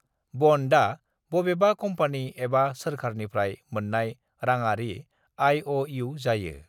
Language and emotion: Bodo, neutral